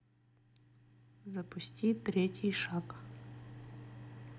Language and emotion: Russian, neutral